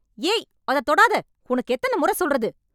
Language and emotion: Tamil, angry